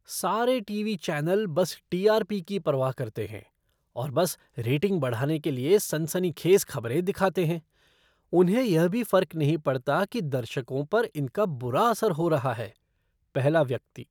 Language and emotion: Hindi, disgusted